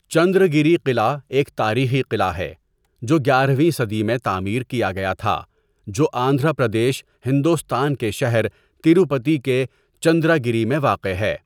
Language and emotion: Urdu, neutral